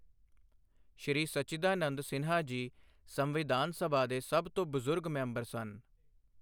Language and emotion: Punjabi, neutral